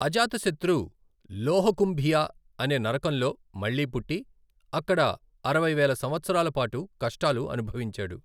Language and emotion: Telugu, neutral